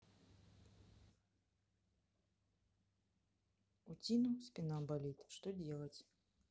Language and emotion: Russian, sad